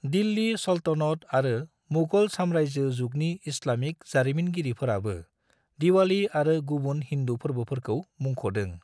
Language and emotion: Bodo, neutral